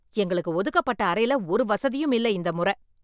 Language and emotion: Tamil, angry